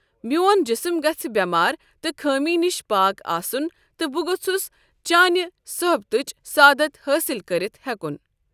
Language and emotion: Kashmiri, neutral